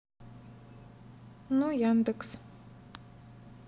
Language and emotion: Russian, neutral